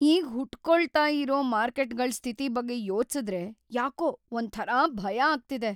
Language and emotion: Kannada, fearful